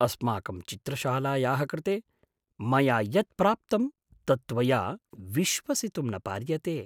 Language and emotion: Sanskrit, surprised